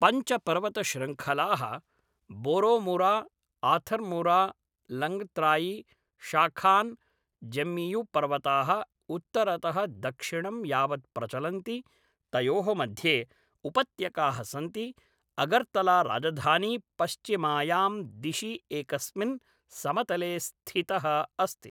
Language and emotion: Sanskrit, neutral